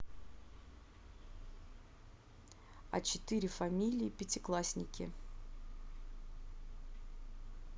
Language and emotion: Russian, neutral